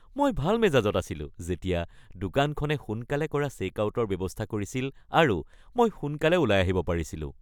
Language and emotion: Assamese, happy